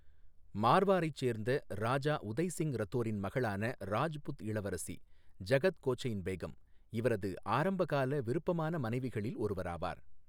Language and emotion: Tamil, neutral